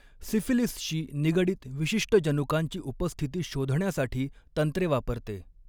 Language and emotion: Marathi, neutral